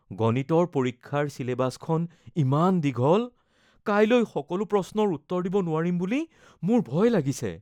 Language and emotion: Assamese, fearful